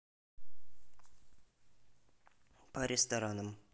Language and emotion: Russian, neutral